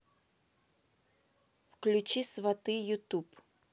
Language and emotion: Russian, neutral